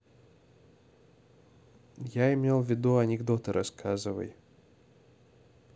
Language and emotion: Russian, neutral